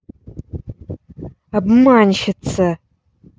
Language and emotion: Russian, angry